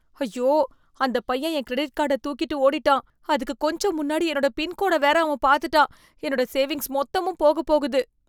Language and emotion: Tamil, fearful